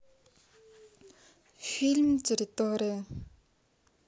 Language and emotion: Russian, neutral